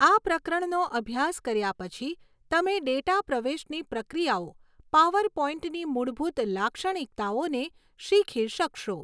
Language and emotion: Gujarati, neutral